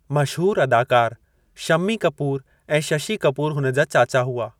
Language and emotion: Sindhi, neutral